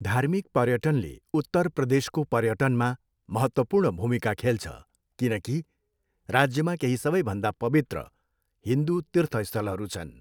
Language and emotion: Nepali, neutral